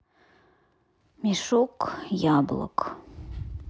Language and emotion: Russian, sad